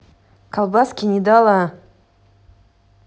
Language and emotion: Russian, angry